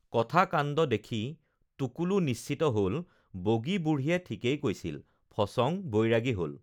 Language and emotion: Assamese, neutral